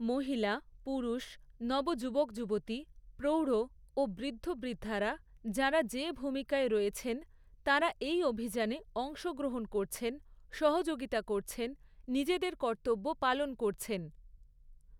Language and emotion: Bengali, neutral